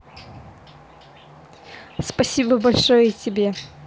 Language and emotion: Russian, positive